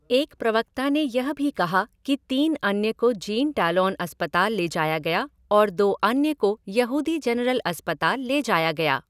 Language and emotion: Hindi, neutral